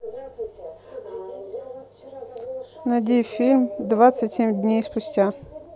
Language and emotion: Russian, neutral